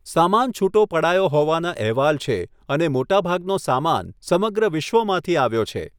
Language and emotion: Gujarati, neutral